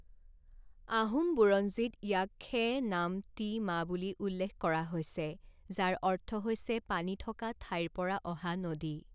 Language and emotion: Assamese, neutral